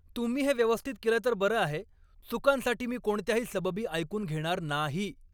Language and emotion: Marathi, angry